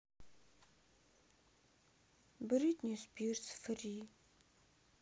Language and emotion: Russian, sad